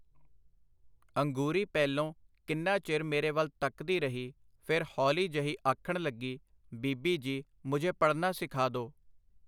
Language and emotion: Punjabi, neutral